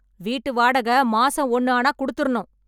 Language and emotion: Tamil, angry